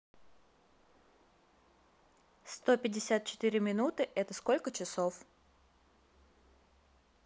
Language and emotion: Russian, neutral